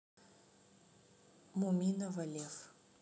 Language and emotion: Russian, neutral